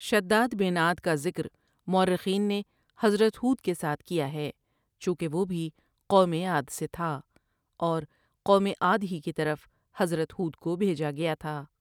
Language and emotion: Urdu, neutral